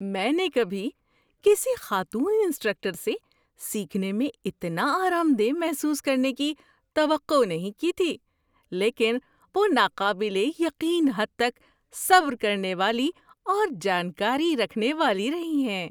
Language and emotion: Urdu, surprised